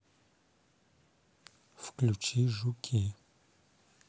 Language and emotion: Russian, neutral